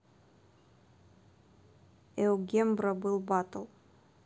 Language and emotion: Russian, neutral